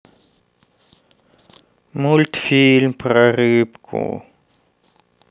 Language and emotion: Russian, sad